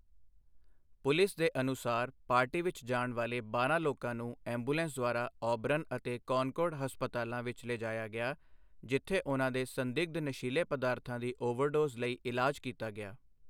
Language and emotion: Punjabi, neutral